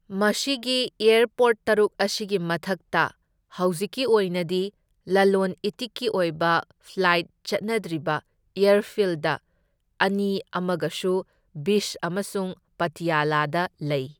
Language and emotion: Manipuri, neutral